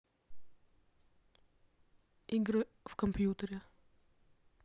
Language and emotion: Russian, neutral